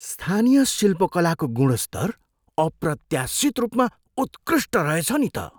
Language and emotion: Nepali, surprised